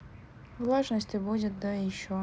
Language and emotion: Russian, neutral